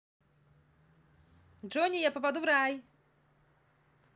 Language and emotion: Russian, positive